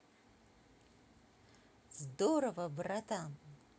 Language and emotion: Russian, positive